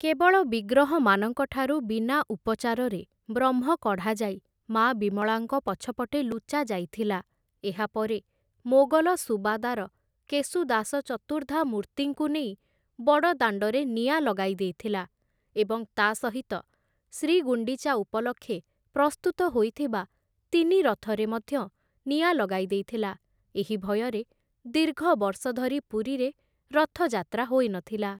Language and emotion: Odia, neutral